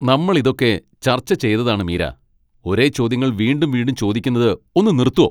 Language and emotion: Malayalam, angry